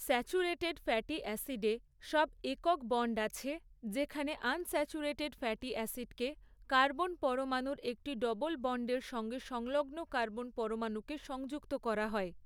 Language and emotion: Bengali, neutral